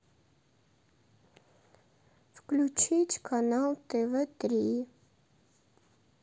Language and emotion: Russian, sad